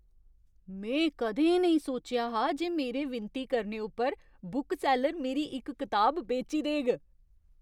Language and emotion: Dogri, surprised